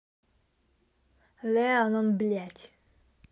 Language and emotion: Russian, angry